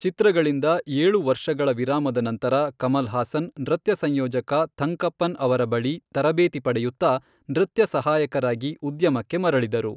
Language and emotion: Kannada, neutral